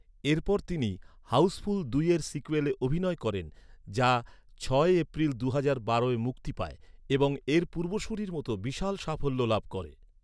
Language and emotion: Bengali, neutral